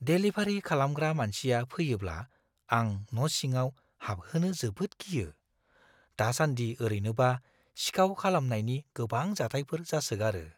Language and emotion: Bodo, fearful